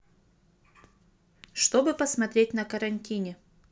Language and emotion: Russian, neutral